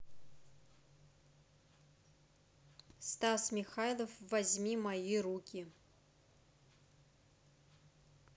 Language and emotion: Russian, neutral